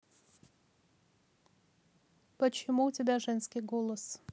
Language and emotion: Russian, neutral